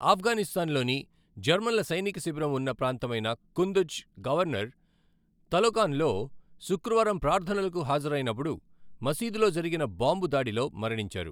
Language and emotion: Telugu, neutral